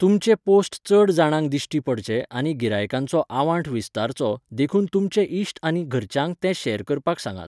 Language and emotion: Goan Konkani, neutral